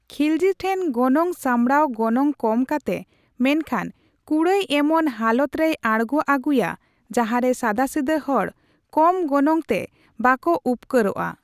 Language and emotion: Santali, neutral